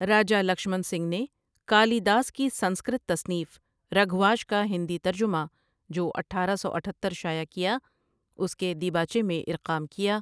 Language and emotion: Urdu, neutral